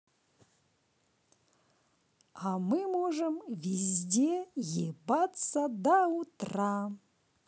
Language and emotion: Russian, positive